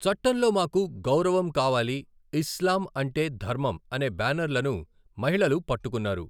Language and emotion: Telugu, neutral